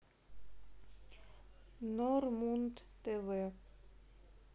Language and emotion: Russian, neutral